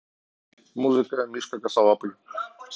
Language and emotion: Russian, neutral